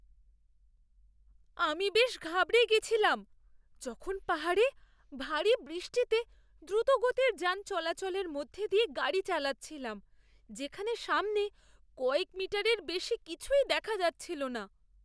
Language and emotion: Bengali, fearful